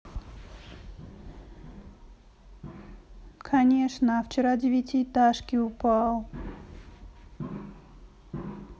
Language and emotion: Russian, sad